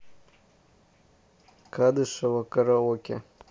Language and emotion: Russian, neutral